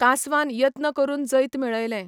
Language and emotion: Goan Konkani, neutral